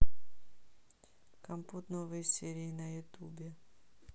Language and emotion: Russian, neutral